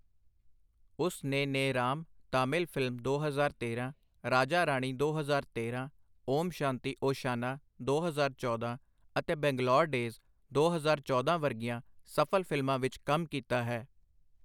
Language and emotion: Punjabi, neutral